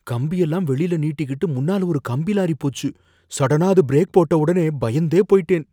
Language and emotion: Tamil, fearful